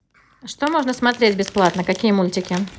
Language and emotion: Russian, neutral